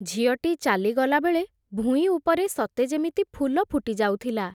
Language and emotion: Odia, neutral